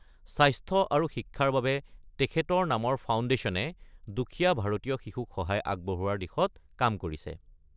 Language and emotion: Assamese, neutral